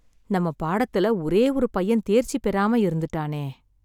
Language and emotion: Tamil, sad